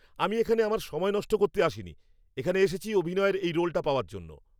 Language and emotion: Bengali, angry